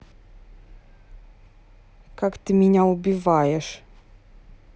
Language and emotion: Russian, neutral